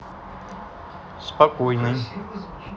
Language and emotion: Russian, neutral